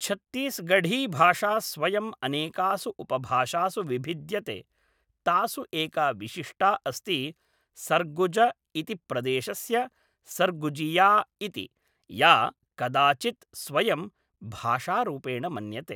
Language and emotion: Sanskrit, neutral